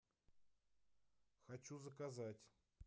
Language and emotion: Russian, neutral